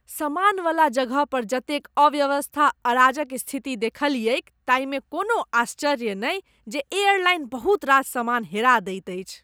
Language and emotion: Maithili, disgusted